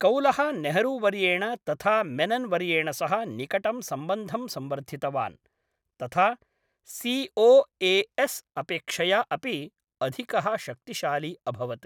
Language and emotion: Sanskrit, neutral